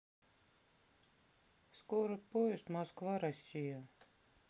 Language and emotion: Russian, sad